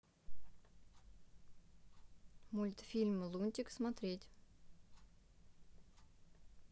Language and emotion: Russian, neutral